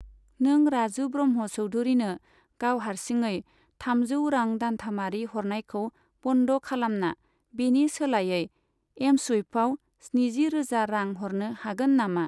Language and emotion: Bodo, neutral